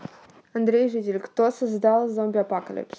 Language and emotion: Russian, neutral